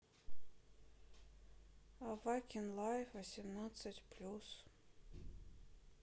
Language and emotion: Russian, sad